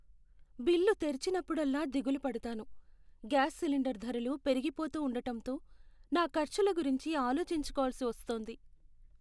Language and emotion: Telugu, sad